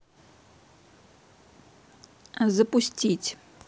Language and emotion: Russian, neutral